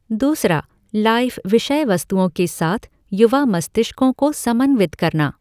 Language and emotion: Hindi, neutral